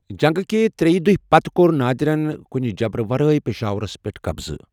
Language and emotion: Kashmiri, neutral